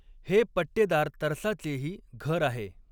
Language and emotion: Marathi, neutral